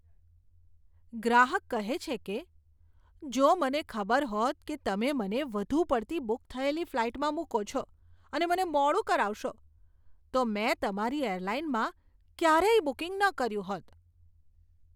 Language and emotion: Gujarati, disgusted